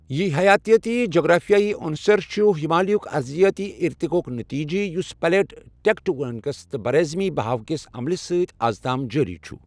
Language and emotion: Kashmiri, neutral